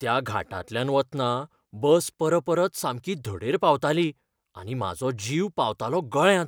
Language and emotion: Goan Konkani, fearful